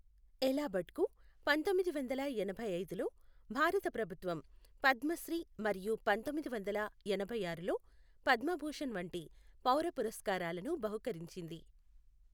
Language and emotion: Telugu, neutral